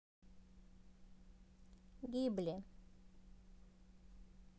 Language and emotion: Russian, neutral